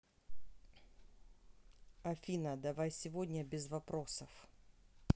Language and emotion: Russian, neutral